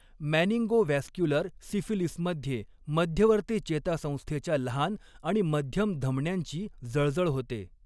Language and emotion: Marathi, neutral